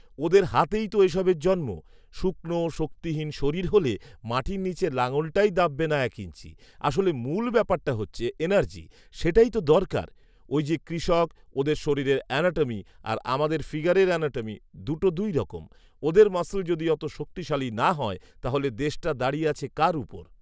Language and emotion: Bengali, neutral